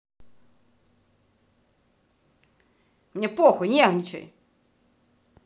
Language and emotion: Russian, angry